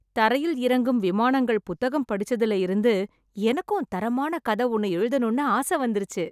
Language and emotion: Tamil, happy